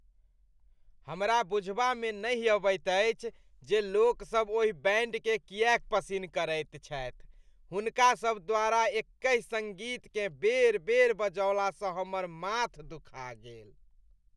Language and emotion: Maithili, disgusted